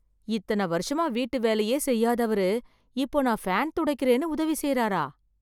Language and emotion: Tamil, surprised